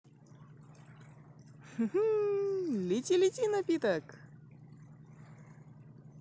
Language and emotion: Russian, positive